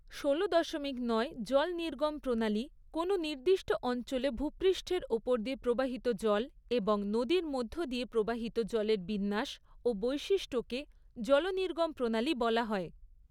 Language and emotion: Bengali, neutral